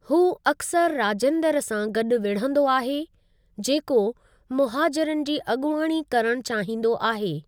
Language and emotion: Sindhi, neutral